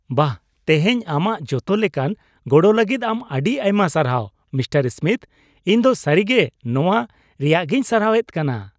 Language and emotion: Santali, happy